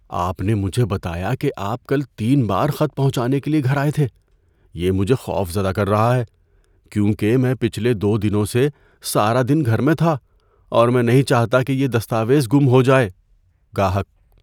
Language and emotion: Urdu, fearful